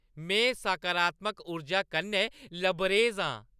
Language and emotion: Dogri, happy